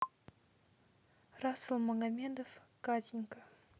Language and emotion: Russian, neutral